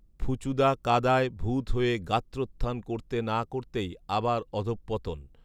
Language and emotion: Bengali, neutral